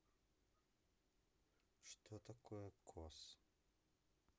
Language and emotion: Russian, neutral